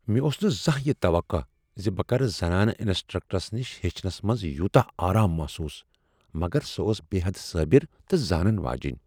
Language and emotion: Kashmiri, surprised